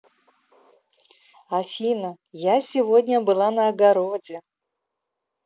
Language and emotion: Russian, positive